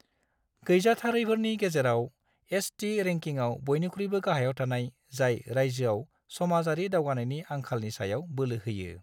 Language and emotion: Bodo, neutral